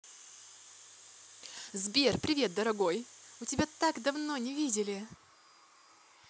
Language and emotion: Russian, positive